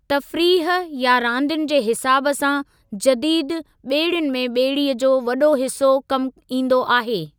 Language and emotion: Sindhi, neutral